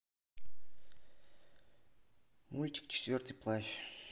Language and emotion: Russian, neutral